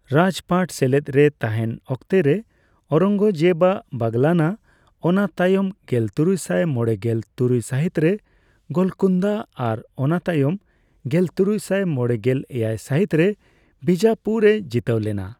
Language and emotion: Santali, neutral